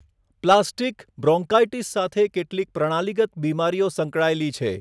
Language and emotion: Gujarati, neutral